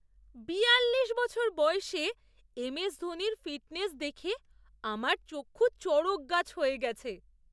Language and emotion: Bengali, surprised